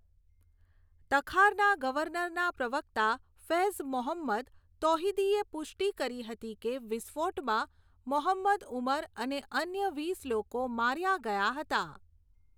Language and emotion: Gujarati, neutral